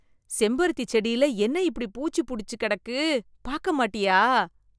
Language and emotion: Tamil, disgusted